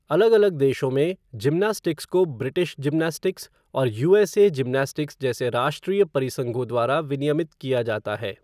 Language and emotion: Hindi, neutral